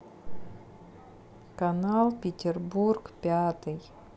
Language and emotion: Russian, sad